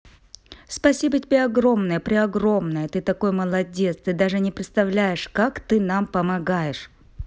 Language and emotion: Russian, positive